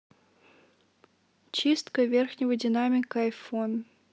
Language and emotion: Russian, neutral